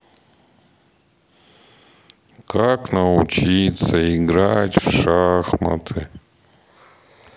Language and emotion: Russian, sad